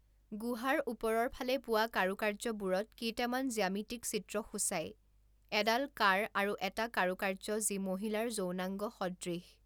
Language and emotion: Assamese, neutral